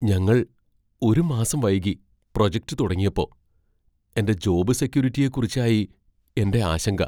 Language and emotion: Malayalam, fearful